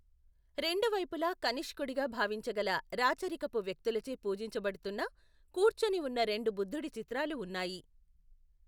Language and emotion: Telugu, neutral